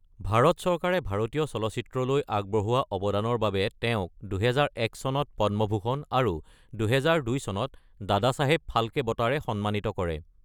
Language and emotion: Assamese, neutral